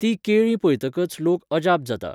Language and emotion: Goan Konkani, neutral